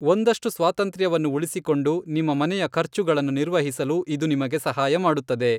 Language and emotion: Kannada, neutral